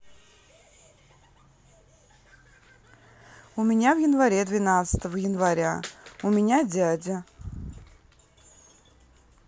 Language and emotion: Russian, neutral